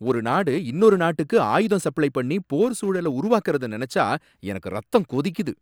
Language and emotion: Tamil, angry